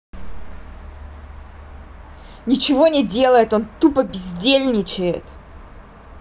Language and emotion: Russian, angry